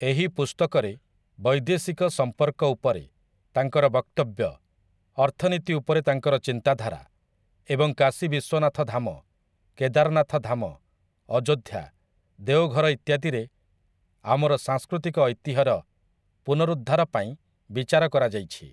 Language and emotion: Odia, neutral